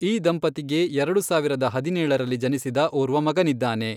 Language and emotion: Kannada, neutral